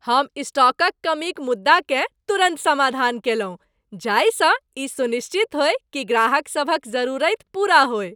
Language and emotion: Maithili, happy